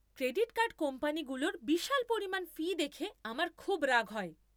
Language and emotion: Bengali, angry